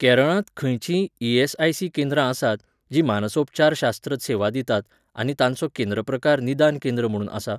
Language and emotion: Goan Konkani, neutral